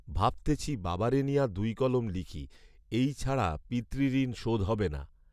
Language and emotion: Bengali, neutral